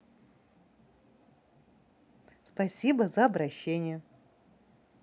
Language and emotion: Russian, positive